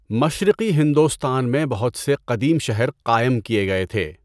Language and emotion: Urdu, neutral